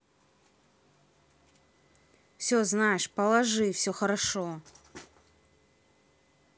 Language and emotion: Russian, neutral